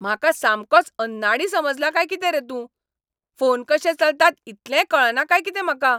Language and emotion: Goan Konkani, angry